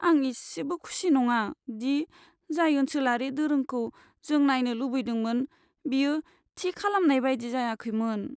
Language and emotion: Bodo, sad